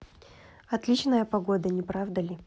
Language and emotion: Russian, neutral